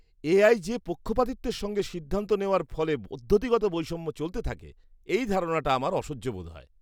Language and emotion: Bengali, disgusted